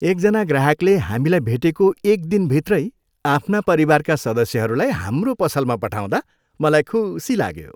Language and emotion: Nepali, happy